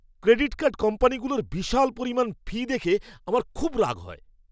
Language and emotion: Bengali, angry